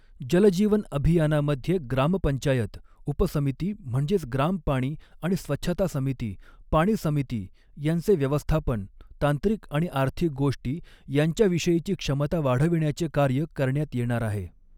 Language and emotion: Marathi, neutral